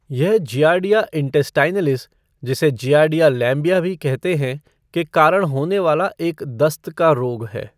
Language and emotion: Hindi, neutral